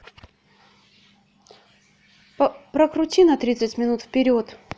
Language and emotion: Russian, neutral